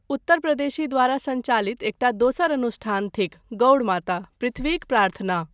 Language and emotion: Maithili, neutral